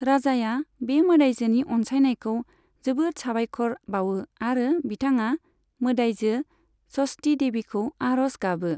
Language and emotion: Bodo, neutral